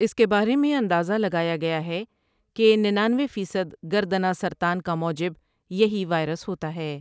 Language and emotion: Urdu, neutral